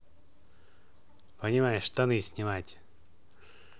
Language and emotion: Russian, neutral